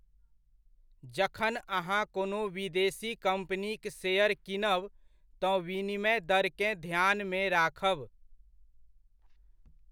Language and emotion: Maithili, neutral